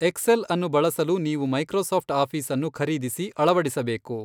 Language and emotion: Kannada, neutral